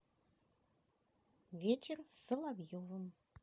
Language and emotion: Russian, positive